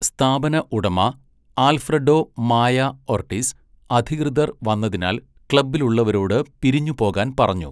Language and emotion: Malayalam, neutral